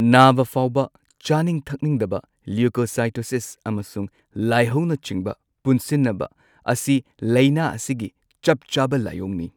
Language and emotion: Manipuri, neutral